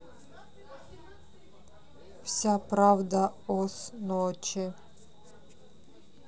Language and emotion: Russian, neutral